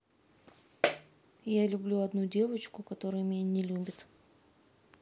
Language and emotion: Russian, sad